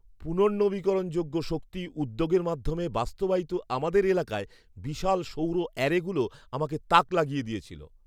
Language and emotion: Bengali, surprised